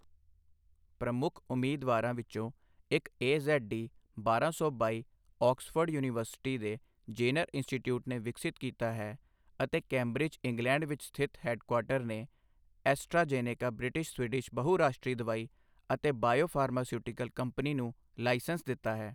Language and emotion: Punjabi, neutral